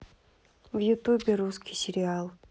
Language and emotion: Russian, neutral